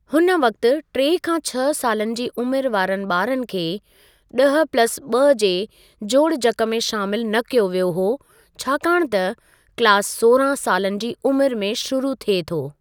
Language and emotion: Sindhi, neutral